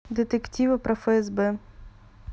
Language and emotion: Russian, neutral